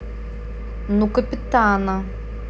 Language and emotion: Russian, neutral